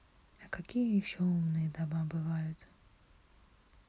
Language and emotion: Russian, neutral